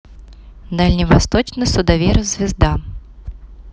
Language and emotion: Russian, neutral